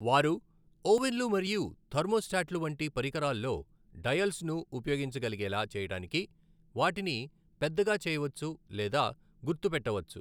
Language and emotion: Telugu, neutral